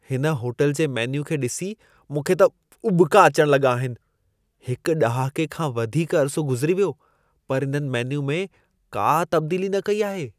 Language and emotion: Sindhi, disgusted